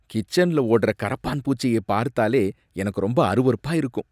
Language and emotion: Tamil, disgusted